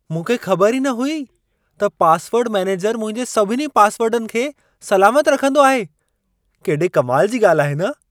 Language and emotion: Sindhi, surprised